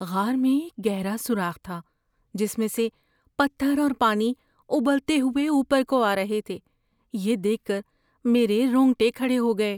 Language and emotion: Urdu, fearful